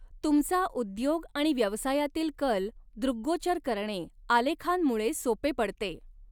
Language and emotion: Marathi, neutral